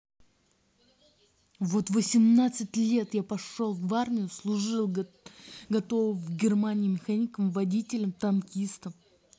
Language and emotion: Russian, angry